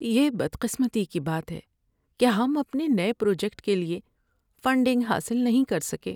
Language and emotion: Urdu, sad